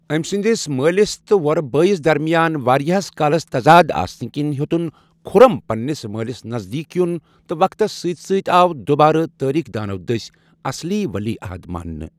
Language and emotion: Kashmiri, neutral